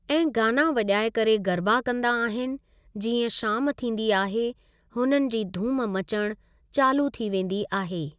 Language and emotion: Sindhi, neutral